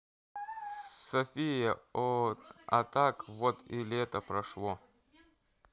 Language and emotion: Russian, neutral